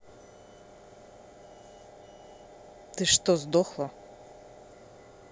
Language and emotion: Russian, angry